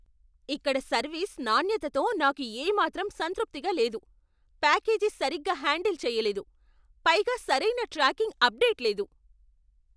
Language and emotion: Telugu, angry